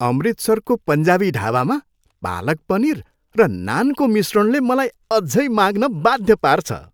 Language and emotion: Nepali, happy